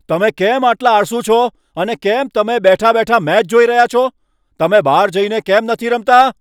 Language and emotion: Gujarati, angry